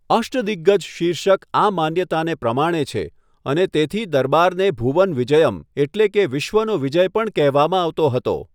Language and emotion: Gujarati, neutral